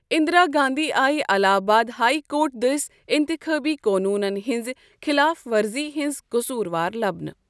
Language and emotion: Kashmiri, neutral